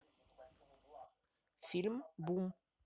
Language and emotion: Russian, neutral